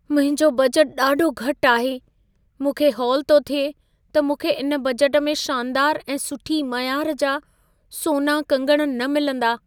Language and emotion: Sindhi, fearful